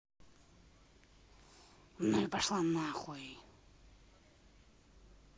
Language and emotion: Russian, angry